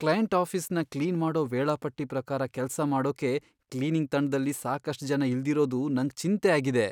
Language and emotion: Kannada, fearful